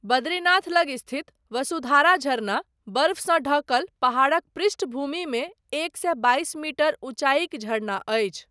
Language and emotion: Maithili, neutral